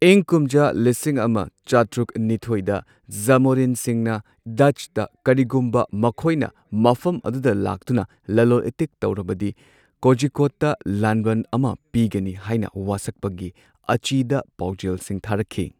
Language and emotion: Manipuri, neutral